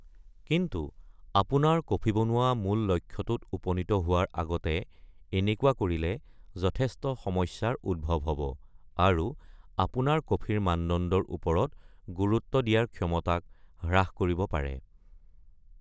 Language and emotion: Assamese, neutral